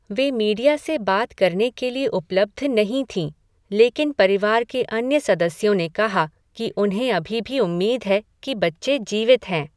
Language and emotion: Hindi, neutral